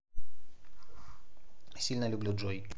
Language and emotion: Russian, neutral